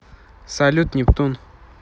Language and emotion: Russian, neutral